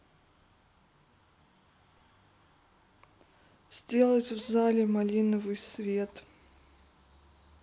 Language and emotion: Russian, neutral